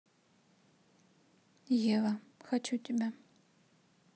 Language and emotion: Russian, neutral